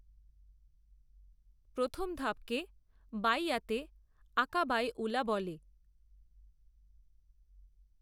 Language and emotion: Bengali, neutral